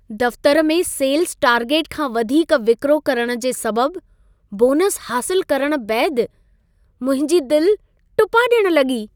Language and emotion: Sindhi, happy